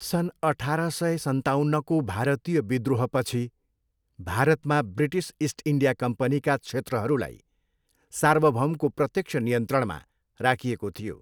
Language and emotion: Nepali, neutral